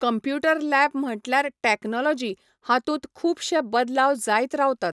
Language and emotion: Goan Konkani, neutral